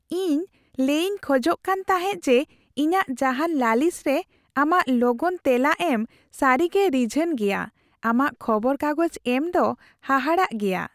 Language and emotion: Santali, happy